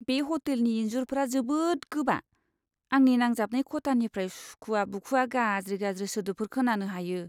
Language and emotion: Bodo, disgusted